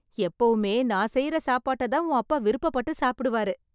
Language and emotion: Tamil, happy